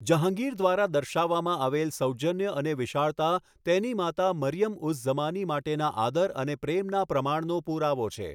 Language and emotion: Gujarati, neutral